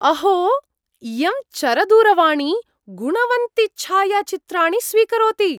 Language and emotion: Sanskrit, surprised